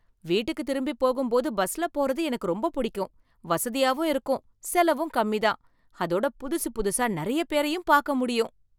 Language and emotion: Tamil, happy